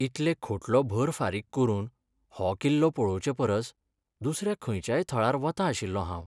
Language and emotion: Goan Konkani, sad